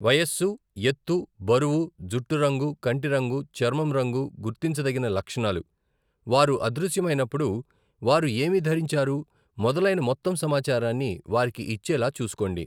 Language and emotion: Telugu, neutral